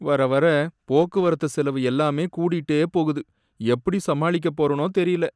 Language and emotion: Tamil, sad